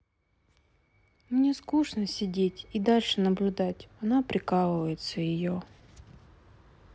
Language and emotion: Russian, sad